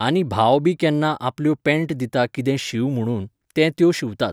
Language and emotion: Goan Konkani, neutral